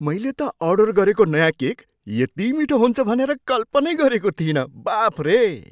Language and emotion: Nepali, surprised